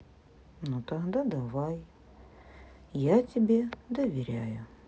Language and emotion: Russian, sad